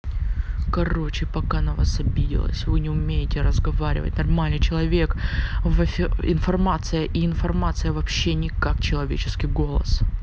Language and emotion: Russian, angry